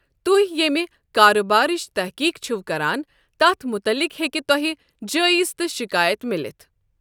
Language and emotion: Kashmiri, neutral